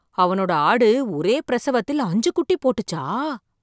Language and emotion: Tamil, surprised